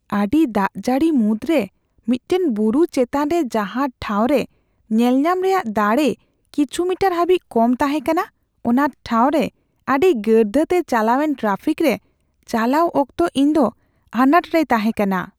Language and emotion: Santali, fearful